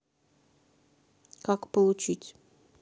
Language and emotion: Russian, neutral